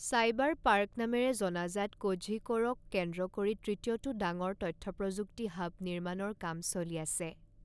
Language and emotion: Assamese, neutral